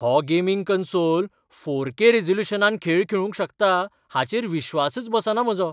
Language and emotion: Goan Konkani, surprised